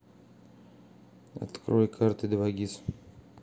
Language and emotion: Russian, neutral